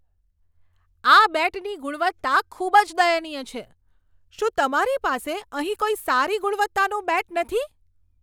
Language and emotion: Gujarati, angry